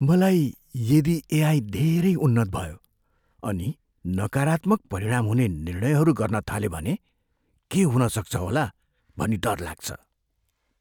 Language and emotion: Nepali, fearful